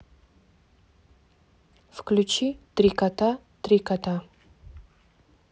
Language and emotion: Russian, neutral